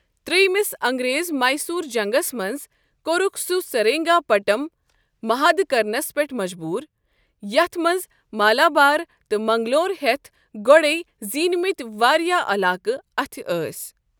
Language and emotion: Kashmiri, neutral